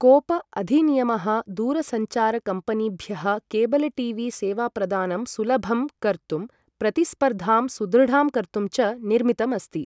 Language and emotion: Sanskrit, neutral